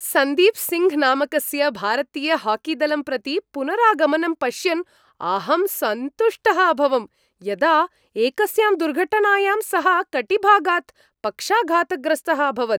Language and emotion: Sanskrit, happy